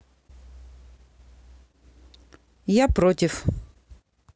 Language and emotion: Russian, neutral